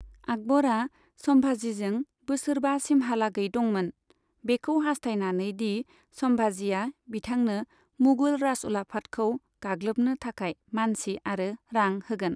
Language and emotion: Bodo, neutral